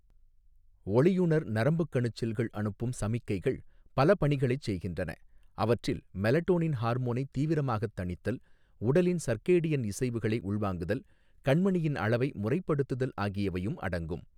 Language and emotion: Tamil, neutral